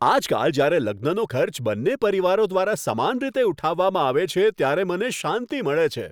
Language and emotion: Gujarati, happy